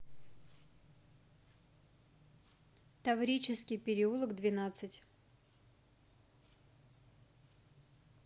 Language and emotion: Russian, neutral